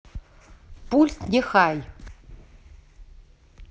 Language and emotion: Russian, neutral